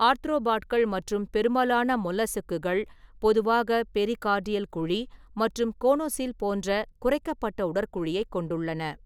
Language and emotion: Tamil, neutral